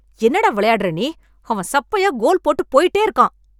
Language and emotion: Tamil, angry